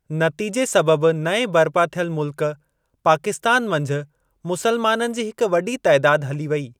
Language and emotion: Sindhi, neutral